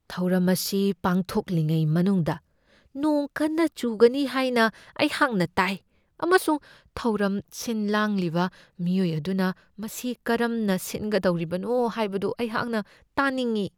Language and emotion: Manipuri, fearful